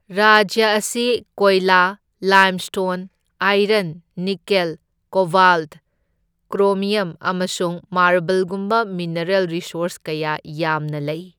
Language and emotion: Manipuri, neutral